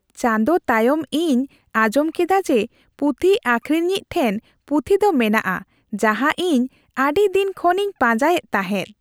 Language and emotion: Santali, happy